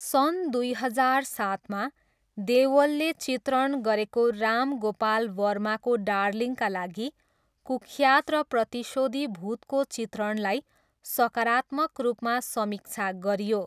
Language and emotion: Nepali, neutral